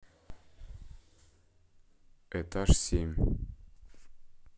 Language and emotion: Russian, neutral